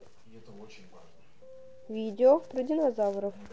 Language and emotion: Russian, neutral